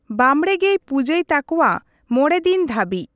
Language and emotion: Santali, neutral